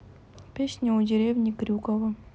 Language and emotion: Russian, neutral